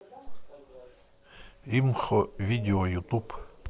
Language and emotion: Russian, neutral